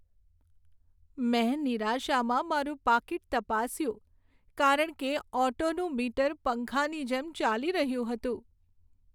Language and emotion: Gujarati, sad